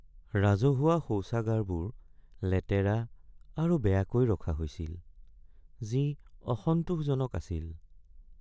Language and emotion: Assamese, sad